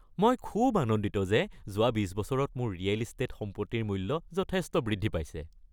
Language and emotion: Assamese, happy